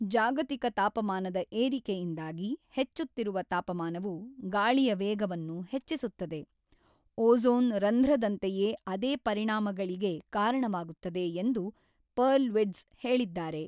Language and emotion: Kannada, neutral